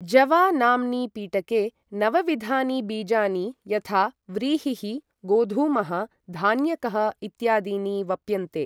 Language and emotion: Sanskrit, neutral